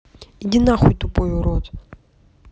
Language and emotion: Russian, angry